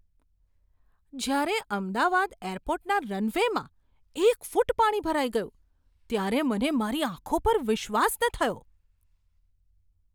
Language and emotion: Gujarati, surprised